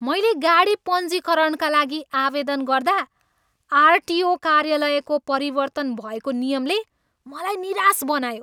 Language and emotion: Nepali, angry